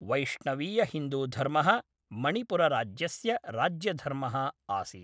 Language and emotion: Sanskrit, neutral